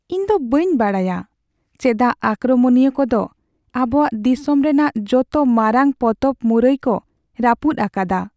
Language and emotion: Santali, sad